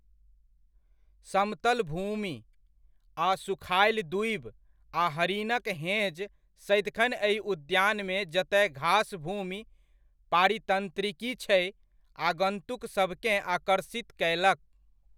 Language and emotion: Maithili, neutral